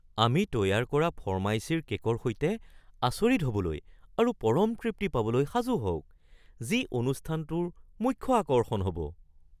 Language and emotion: Assamese, surprised